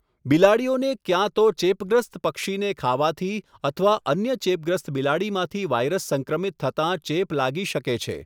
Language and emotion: Gujarati, neutral